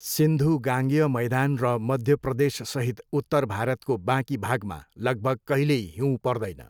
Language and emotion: Nepali, neutral